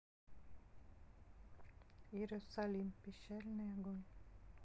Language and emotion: Russian, sad